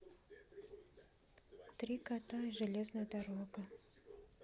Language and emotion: Russian, neutral